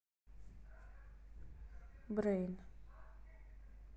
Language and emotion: Russian, neutral